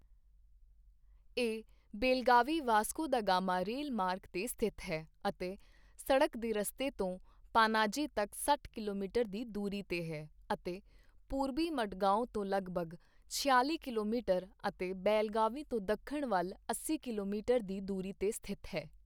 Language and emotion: Punjabi, neutral